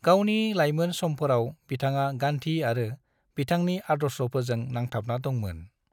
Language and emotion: Bodo, neutral